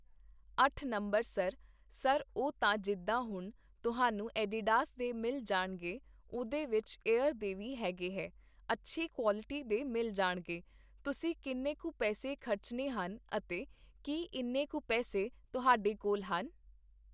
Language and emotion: Punjabi, neutral